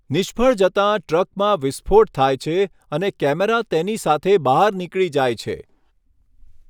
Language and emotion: Gujarati, neutral